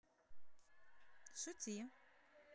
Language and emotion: Russian, positive